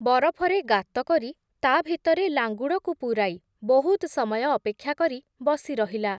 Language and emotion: Odia, neutral